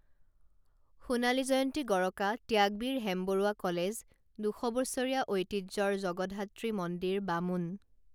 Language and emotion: Assamese, neutral